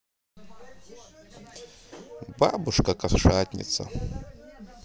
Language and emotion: Russian, positive